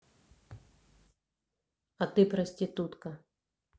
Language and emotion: Russian, neutral